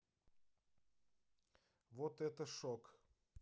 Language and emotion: Russian, neutral